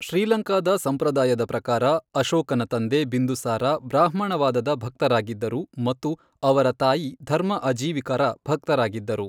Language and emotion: Kannada, neutral